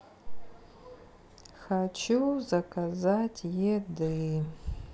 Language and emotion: Russian, sad